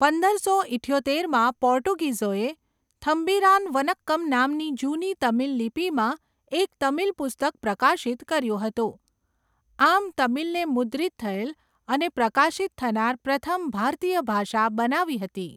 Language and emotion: Gujarati, neutral